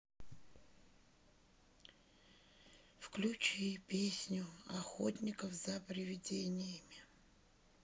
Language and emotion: Russian, sad